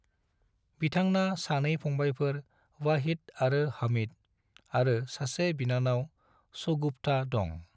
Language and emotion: Bodo, neutral